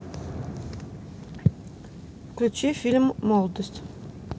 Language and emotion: Russian, neutral